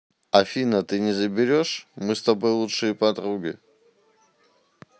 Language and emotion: Russian, neutral